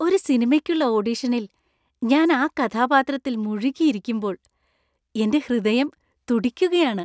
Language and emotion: Malayalam, happy